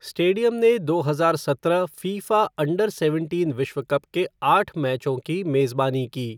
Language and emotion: Hindi, neutral